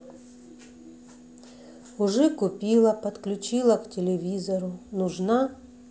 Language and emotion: Russian, neutral